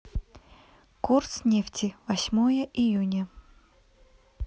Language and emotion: Russian, neutral